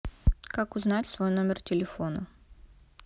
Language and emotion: Russian, neutral